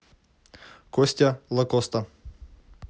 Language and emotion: Russian, neutral